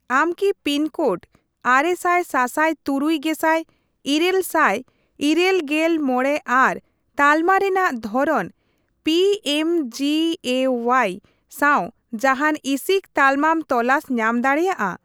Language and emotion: Santali, neutral